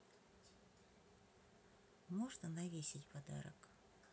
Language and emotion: Russian, neutral